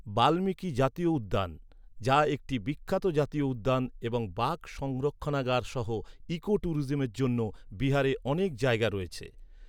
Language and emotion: Bengali, neutral